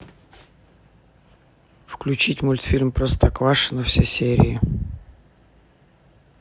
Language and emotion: Russian, neutral